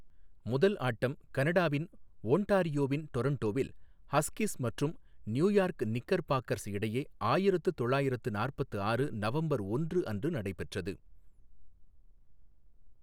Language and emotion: Tamil, neutral